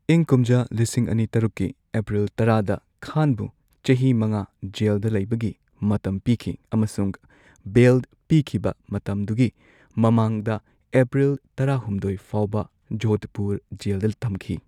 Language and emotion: Manipuri, neutral